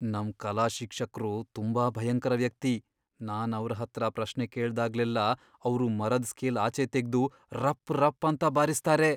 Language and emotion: Kannada, fearful